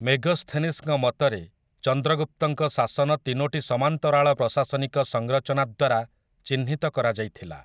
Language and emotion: Odia, neutral